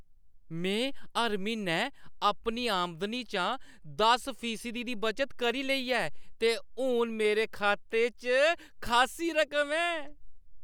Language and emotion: Dogri, happy